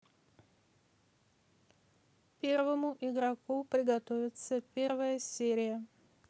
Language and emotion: Russian, neutral